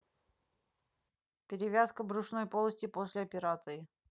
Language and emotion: Russian, neutral